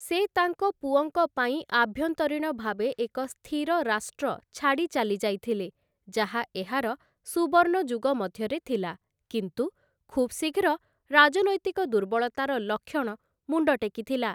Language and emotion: Odia, neutral